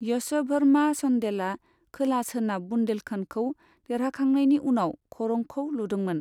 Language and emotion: Bodo, neutral